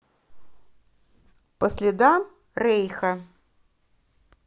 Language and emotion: Russian, neutral